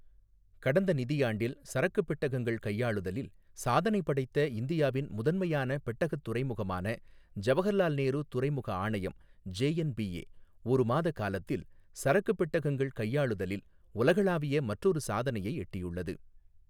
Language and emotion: Tamil, neutral